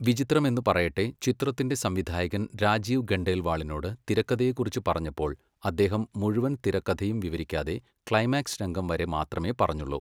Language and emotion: Malayalam, neutral